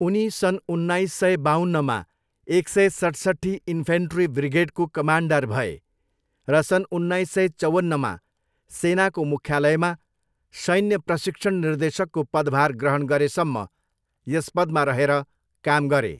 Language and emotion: Nepali, neutral